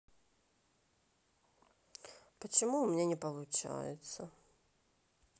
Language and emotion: Russian, sad